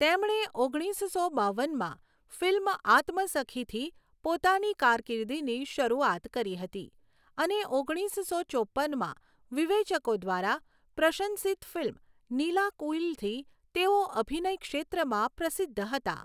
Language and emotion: Gujarati, neutral